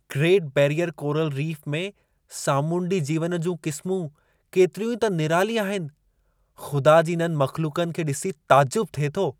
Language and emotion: Sindhi, surprised